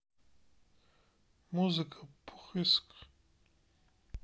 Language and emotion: Russian, sad